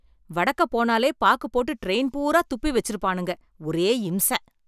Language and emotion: Tamil, angry